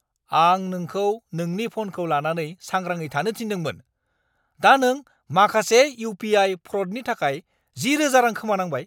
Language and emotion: Bodo, angry